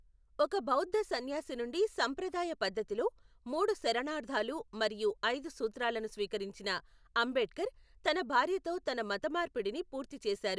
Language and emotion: Telugu, neutral